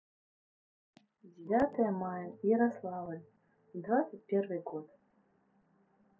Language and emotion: Russian, neutral